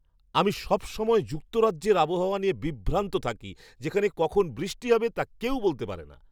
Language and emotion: Bengali, surprised